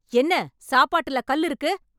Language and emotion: Tamil, angry